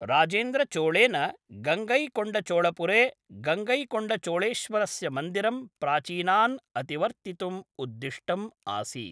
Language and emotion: Sanskrit, neutral